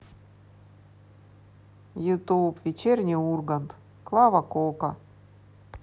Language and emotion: Russian, positive